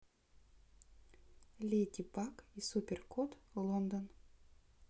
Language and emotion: Russian, neutral